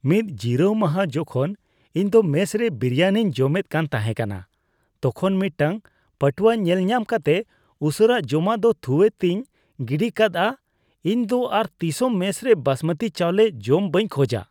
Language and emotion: Santali, disgusted